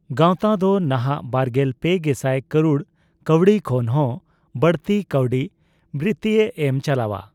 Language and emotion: Santali, neutral